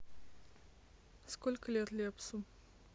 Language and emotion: Russian, neutral